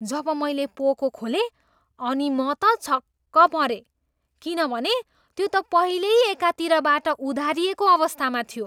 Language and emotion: Nepali, surprised